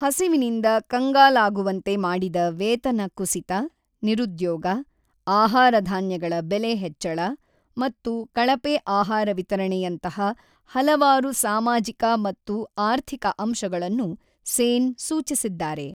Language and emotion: Kannada, neutral